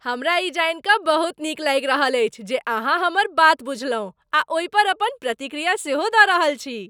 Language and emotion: Maithili, happy